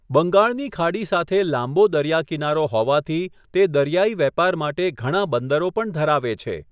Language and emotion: Gujarati, neutral